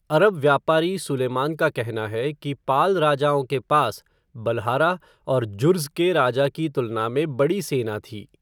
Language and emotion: Hindi, neutral